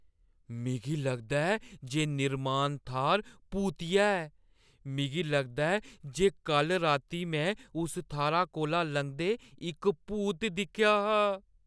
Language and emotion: Dogri, fearful